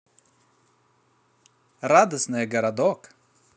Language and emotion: Russian, positive